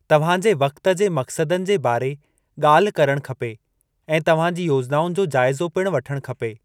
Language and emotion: Sindhi, neutral